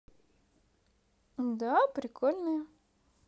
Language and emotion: Russian, positive